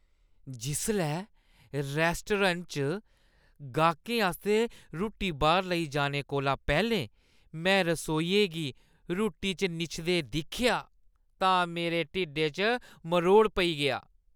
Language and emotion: Dogri, disgusted